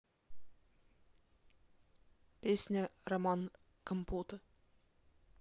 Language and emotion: Russian, neutral